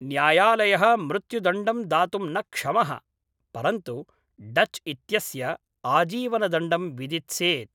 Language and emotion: Sanskrit, neutral